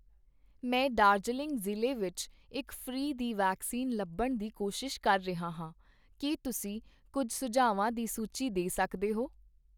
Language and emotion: Punjabi, neutral